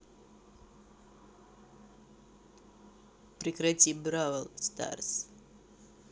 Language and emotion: Russian, neutral